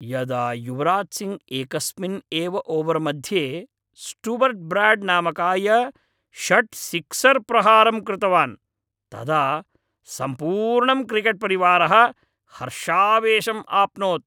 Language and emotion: Sanskrit, happy